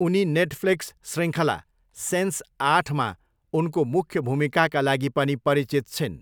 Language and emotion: Nepali, neutral